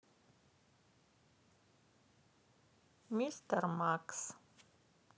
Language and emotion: Russian, neutral